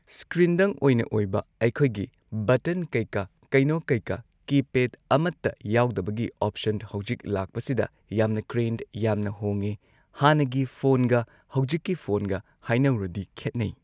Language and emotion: Manipuri, neutral